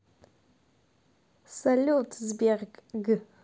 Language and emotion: Russian, positive